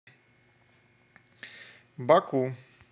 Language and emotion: Russian, neutral